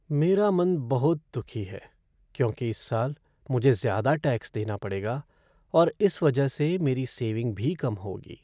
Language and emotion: Hindi, sad